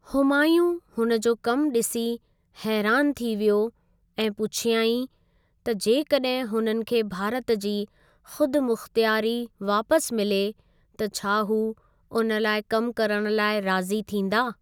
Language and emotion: Sindhi, neutral